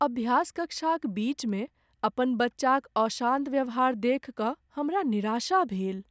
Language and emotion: Maithili, sad